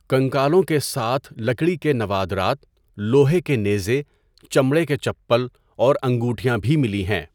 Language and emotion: Urdu, neutral